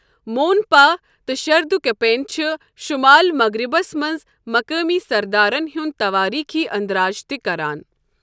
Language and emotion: Kashmiri, neutral